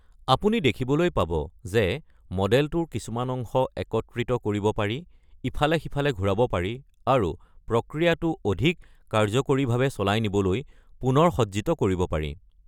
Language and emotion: Assamese, neutral